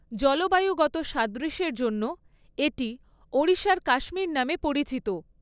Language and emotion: Bengali, neutral